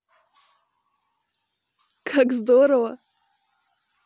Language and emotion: Russian, positive